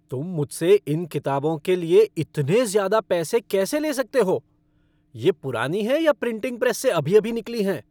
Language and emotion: Hindi, angry